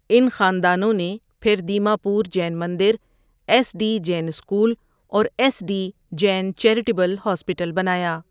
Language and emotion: Urdu, neutral